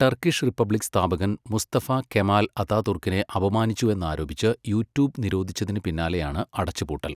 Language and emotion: Malayalam, neutral